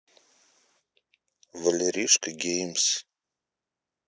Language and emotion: Russian, neutral